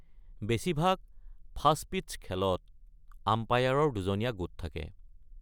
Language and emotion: Assamese, neutral